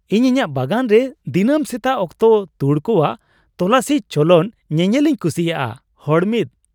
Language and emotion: Santali, happy